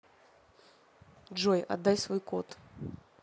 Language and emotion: Russian, neutral